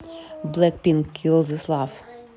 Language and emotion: Russian, neutral